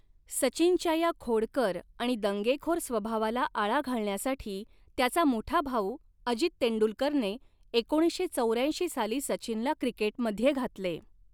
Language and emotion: Marathi, neutral